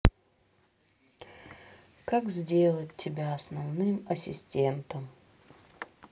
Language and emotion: Russian, sad